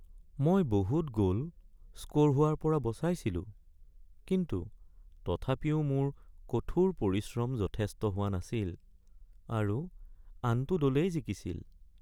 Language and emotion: Assamese, sad